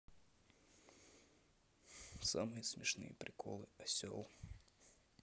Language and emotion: Russian, sad